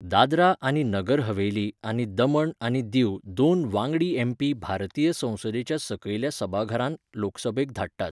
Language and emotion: Goan Konkani, neutral